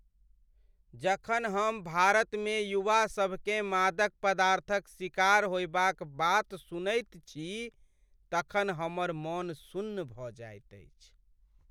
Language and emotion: Maithili, sad